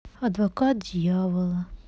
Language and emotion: Russian, sad